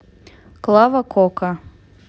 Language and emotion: Russian, neutral